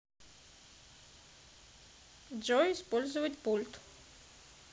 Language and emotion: Russian, neutral